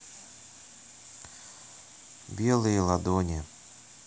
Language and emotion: Russian, neutral